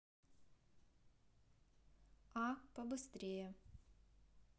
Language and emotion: Russian, neutral